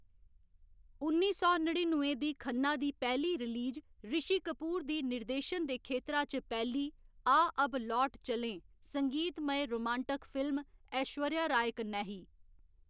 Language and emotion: Dogri, neutral